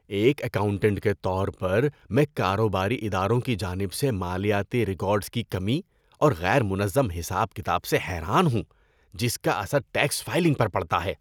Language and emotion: Urdu, disgusted